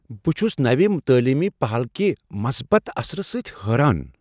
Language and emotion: Kashmiri, surprised